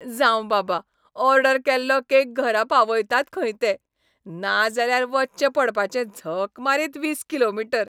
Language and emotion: Goan Konkani, happy